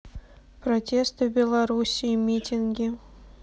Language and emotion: Russian, neutral